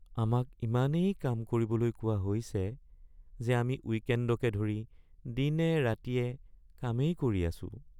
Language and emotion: Assamese, sad